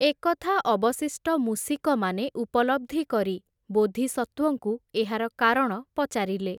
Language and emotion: Odia, neutral